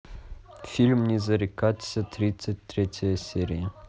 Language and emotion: Russian, neutral